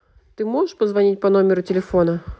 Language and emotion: Russian, neutral